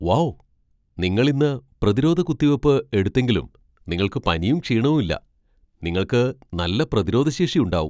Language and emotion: Malayalam, surprised